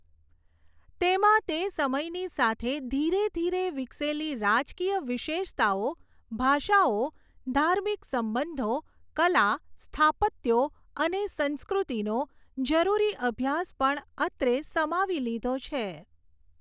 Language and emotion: Gujarati, neutral